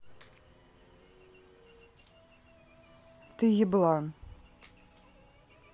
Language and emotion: Russian, neutral